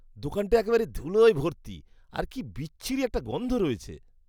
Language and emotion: Bengali, disgusted